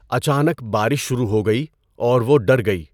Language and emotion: Urdu, neutral